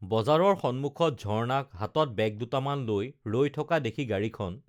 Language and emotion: Assamese, neutral